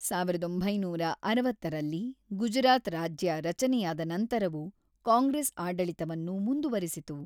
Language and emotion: Kannada, neutral